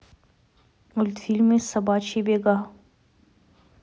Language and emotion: Russian, neutral